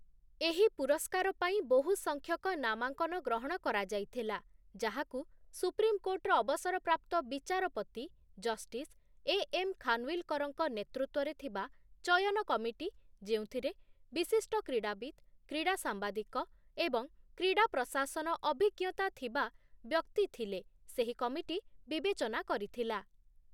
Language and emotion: Odia, neutral